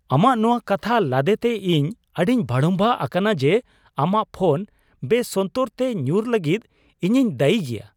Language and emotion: Santali, surprised